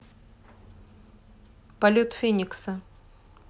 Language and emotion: Russian, neutral